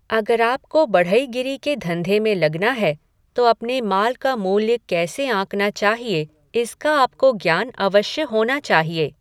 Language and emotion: Hindi, neutral